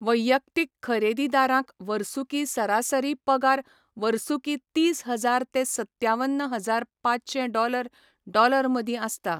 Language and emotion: Goan Konkani, neutral